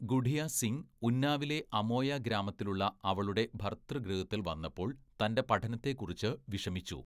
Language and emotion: Malayalam, neutral